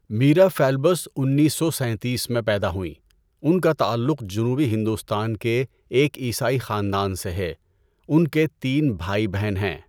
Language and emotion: Urdu, neutral